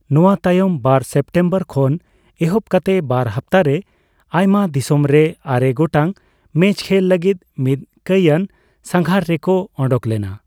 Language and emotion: Santali, neutral